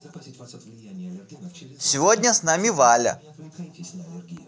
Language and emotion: Russian, positive